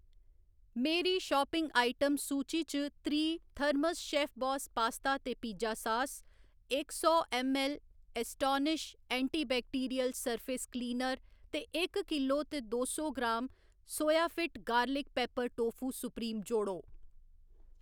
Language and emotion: Dogri, neutral